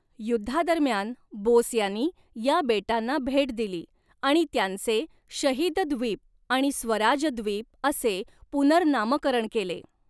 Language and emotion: Marathi, neutral